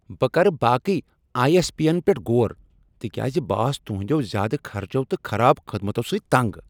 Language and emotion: Kashmiri, angry